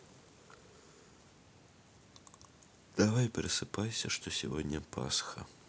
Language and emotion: Russian, sad